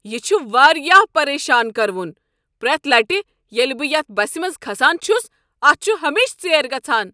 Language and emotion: Kashmiri, angry